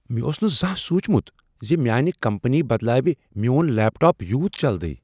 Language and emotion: Kashmiri, surprised